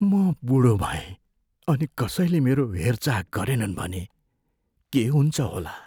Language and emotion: Nepali, fearful